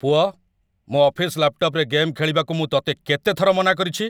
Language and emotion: Odia, angry